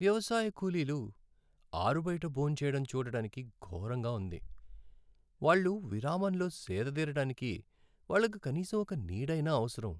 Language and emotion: Telugu, sad